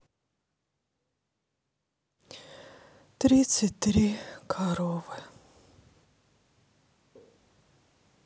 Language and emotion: Russian, sad